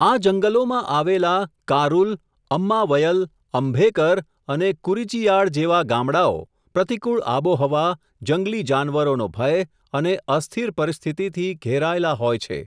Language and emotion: Gujarati, neutral